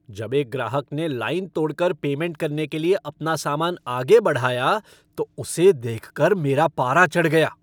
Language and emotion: Hindi, angry